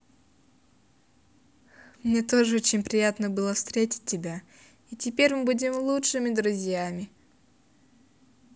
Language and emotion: Russian, positive